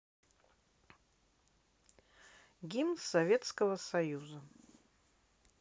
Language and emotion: Russian, neutral